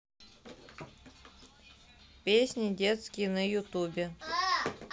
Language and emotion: Russian, neutral